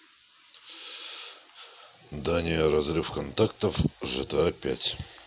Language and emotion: Russian, neutral